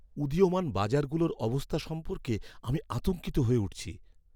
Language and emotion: Bengali, fearful